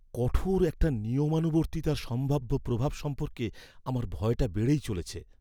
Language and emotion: Bengali, fearful